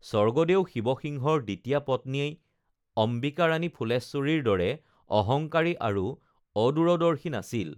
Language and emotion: Assamese, neutral